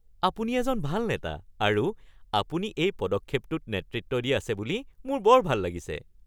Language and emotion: Assamese, happy